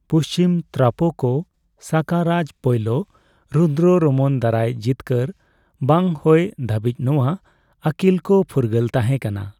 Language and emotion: Santali, neutral